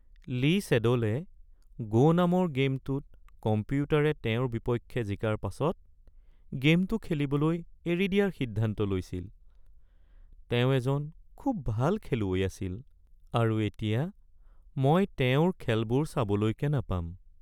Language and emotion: Assamese, sad